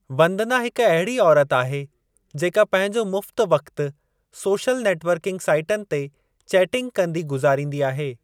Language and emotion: Sindhi, neutral